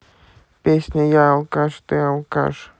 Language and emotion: Russian, neutral